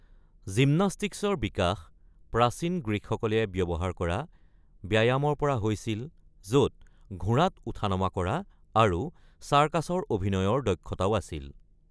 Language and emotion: Assamese, neutral